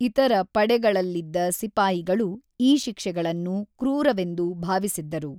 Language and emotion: Kannada, neutral